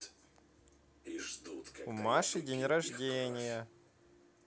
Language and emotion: Russian, positive